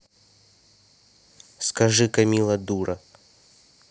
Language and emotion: Russian, neutral